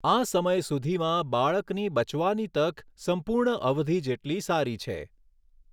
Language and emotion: Gujarati, neutral